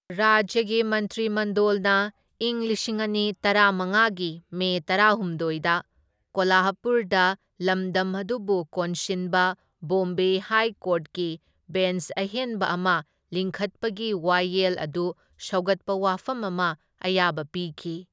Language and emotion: Manipuri, neutral